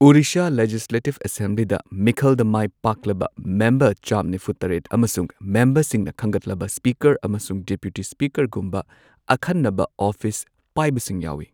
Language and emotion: Manipuri, neutral